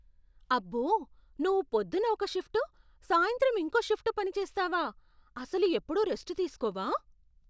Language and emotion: Telugu, surprised